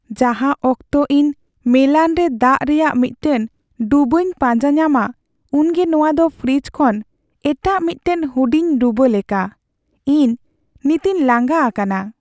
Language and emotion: Santali, sad